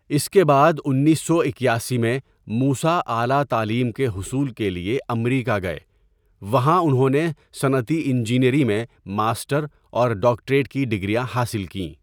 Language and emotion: Urdu, neutral